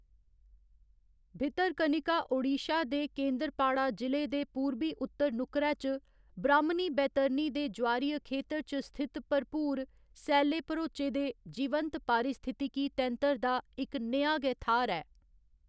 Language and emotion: Dogri, neutral